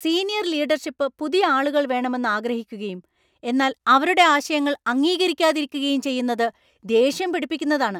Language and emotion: Malayalam, angry